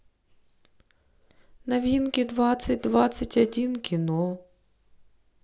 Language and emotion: Russian, neutral